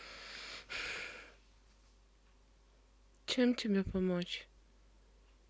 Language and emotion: Russian, sad